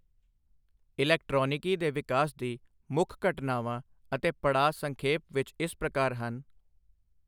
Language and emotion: Punjabi, neutral